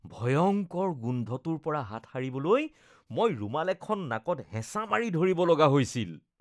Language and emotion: Assamese, disgusted